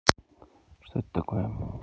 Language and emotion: Russian, neutral